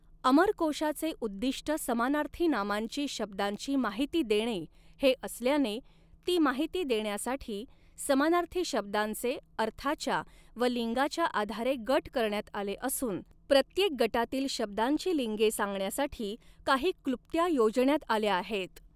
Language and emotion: Marathi, neutral